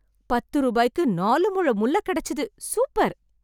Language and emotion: Tamil, happy